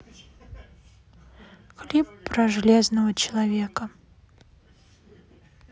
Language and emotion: Russian, sad